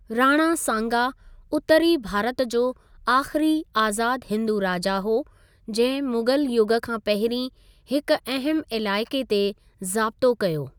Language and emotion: Sindhi, neutral